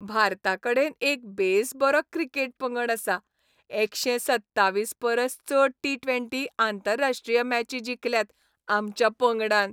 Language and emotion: Goan Konkani, happy